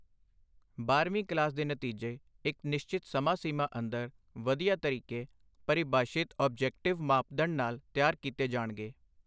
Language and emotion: Punjabi, neutral